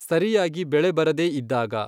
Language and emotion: Kannada, neutral